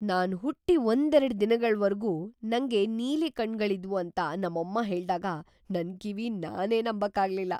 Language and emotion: Kannada, surprised